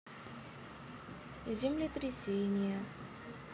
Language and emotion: Russian, neutral